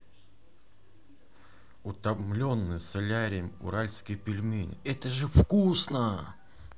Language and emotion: Russian, positive